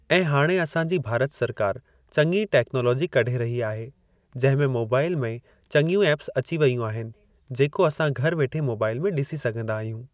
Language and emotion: Sindhi, neutral